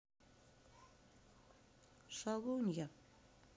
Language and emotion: Russian, sad